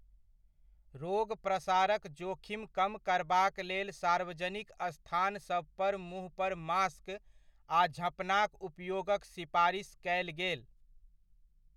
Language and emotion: Maithili, neutral